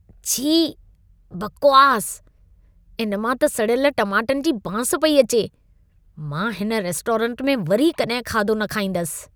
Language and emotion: Sindhi, disgusted